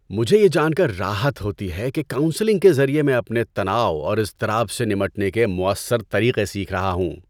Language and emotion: Urdu, happy